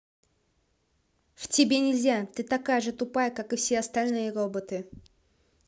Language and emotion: Russian, angry